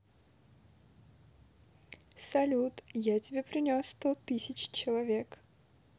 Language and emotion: Russian, positive